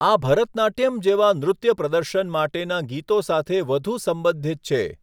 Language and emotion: Gujarati, neutral